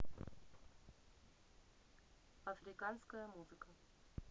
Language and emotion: Russian, neutral